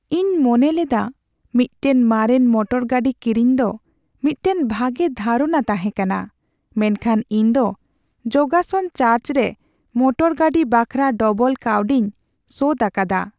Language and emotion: Santali, sad